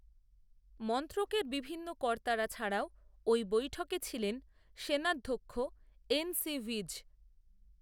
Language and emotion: Bengali, neutral